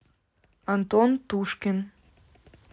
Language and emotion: Russian, neutral